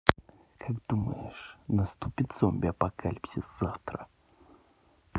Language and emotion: Russian, neutral